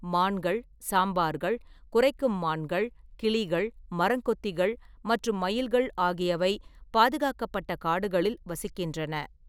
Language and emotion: Tamil, neutral